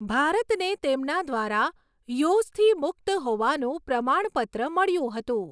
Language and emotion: Gujarati, neutral